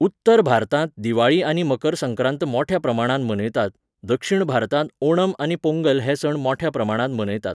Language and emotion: Goan Konkani, neutral